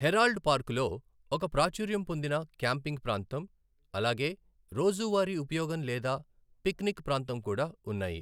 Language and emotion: Telugu, neutral